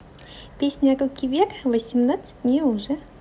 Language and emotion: Russian, positive